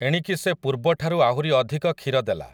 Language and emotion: Odia, neutral